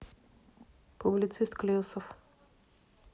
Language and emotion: Russian, neutral